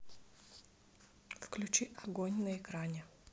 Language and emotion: Russian, neutral